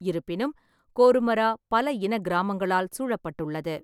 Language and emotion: Tamil, neutral